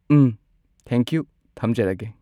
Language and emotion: Manipuri, neutral